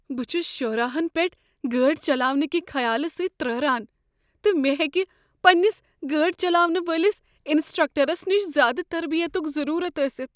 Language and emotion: Kashmiri, fearful